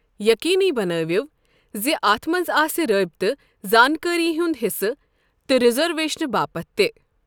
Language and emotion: Kashmiri, neutral